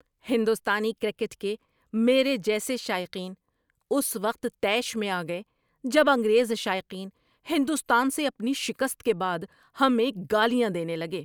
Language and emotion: Urdu, angry